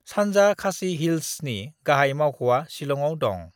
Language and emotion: Bodo, neutral